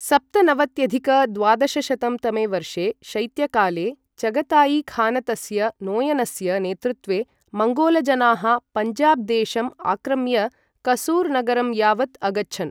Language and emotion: Sanskrit, neutral